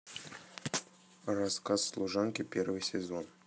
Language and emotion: Russian, neutral